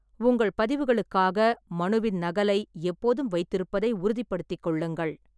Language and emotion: Tamil, neutral